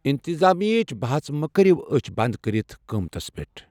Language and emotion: Kashmiri, neutral